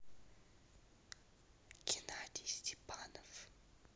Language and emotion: Russian, neutral